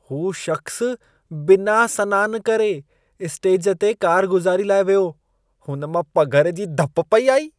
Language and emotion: Sindhi, disgusted